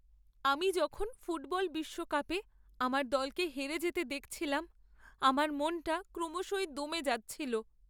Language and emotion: Bengali, sad